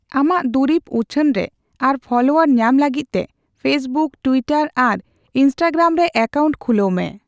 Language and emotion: Santali, neutral